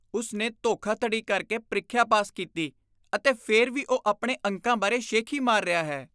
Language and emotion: Punjabi, disgusted